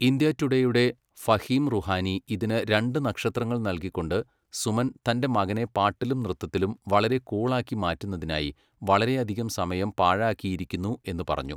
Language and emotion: Malayalam, neutral